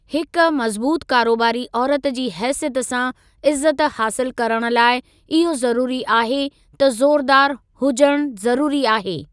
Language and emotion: Sindhi, neutral